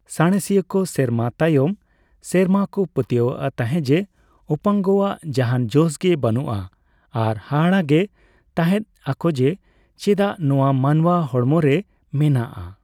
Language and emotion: Santali, neutral